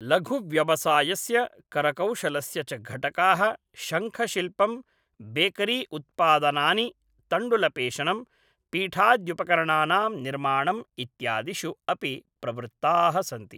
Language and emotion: Sanskrit, neutral